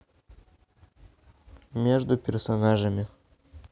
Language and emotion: Russian, neutral